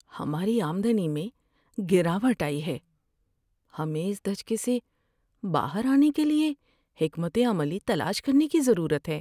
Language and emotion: Urdu, sad